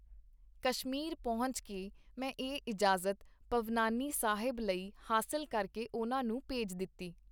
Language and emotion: Punjabi, neutral